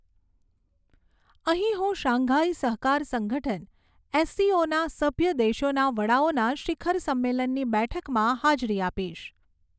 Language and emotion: Gujarati, neutral